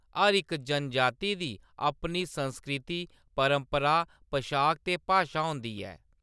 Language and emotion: Dogri, neutral